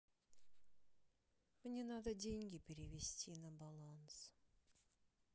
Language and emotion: Russian, sad